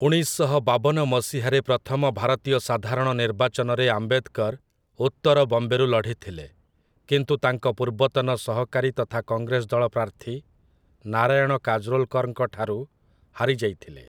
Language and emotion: Odia, neutral